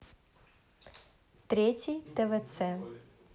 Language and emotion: Russian, neutral